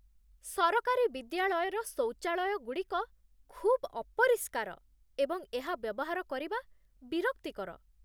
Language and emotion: Odia, disgusted